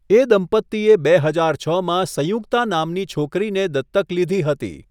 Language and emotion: Gujarati, neutral